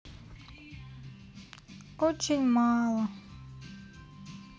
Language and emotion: Russian, sad